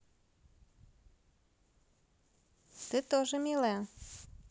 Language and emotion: Russian, positive